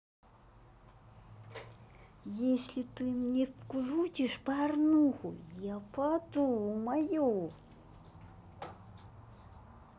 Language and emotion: Russian, neutral